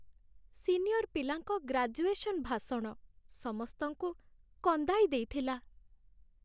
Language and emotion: Odia, sad